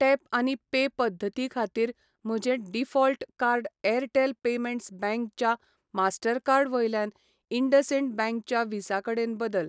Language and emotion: Goan Konkani, neutral